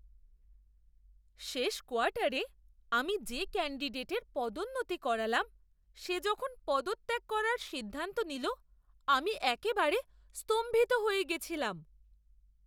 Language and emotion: Bengali, surprised